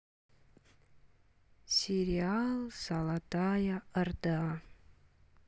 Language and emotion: Russian, sad